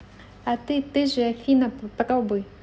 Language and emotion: Russian, neutral